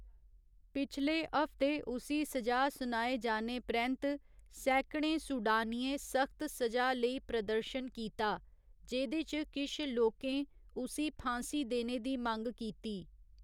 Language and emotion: Dogri, neutral